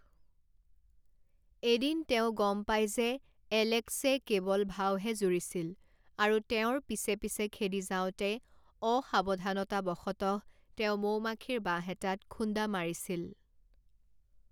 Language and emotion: Assamese, neutral